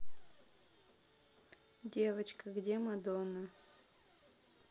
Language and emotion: Russian, neutral